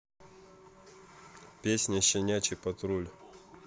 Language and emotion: Russian, neutral